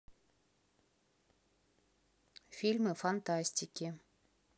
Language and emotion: Russian, neutral